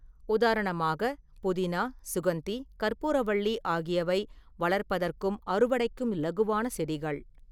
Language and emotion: Tamil, neutral